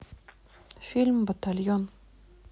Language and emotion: Russian, neutral